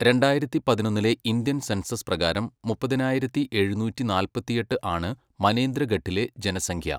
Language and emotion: Malayalam, neutral